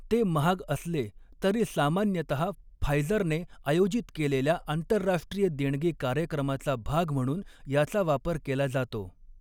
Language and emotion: Marathi, neutral